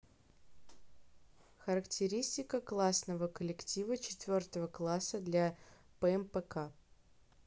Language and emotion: Russian, neutral